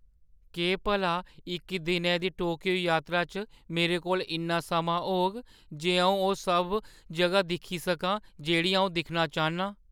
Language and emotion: Dogri, fearful